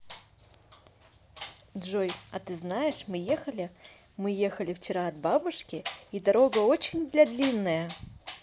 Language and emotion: Russian, positive